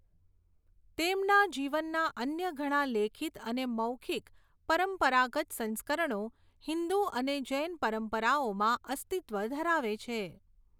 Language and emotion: Gujarati, neutral